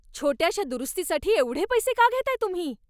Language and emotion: Marathi, angry